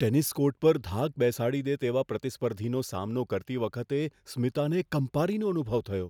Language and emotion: Gujarati, fearful